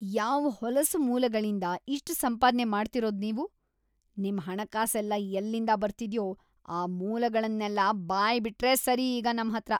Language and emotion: Kannada, disgusted